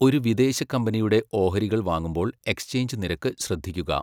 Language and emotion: Malayalam, neutral